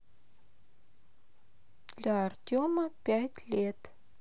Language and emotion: Russian, neutral